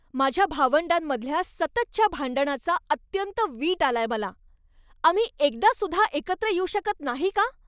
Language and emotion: Marathi, angry